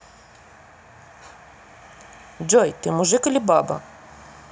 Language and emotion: Russian, neutral